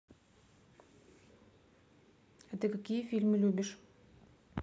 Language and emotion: Russian, neutral